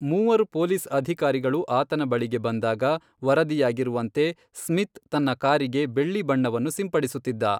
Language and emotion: Kannada, neutral